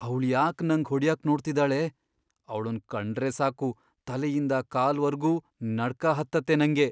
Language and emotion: Kannada, fearful